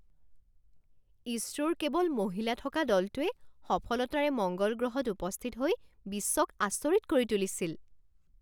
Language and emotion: Assamese, surprised